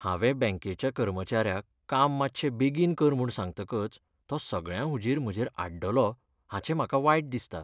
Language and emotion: Goan Konkani, sad